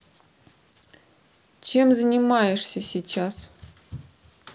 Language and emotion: Russian, neutral